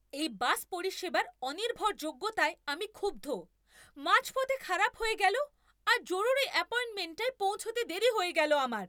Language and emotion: Bengali, angry